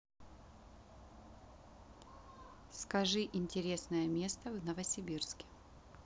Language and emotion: Russian, neutral